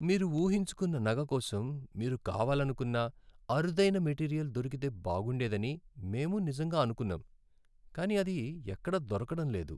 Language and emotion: Telugu, sad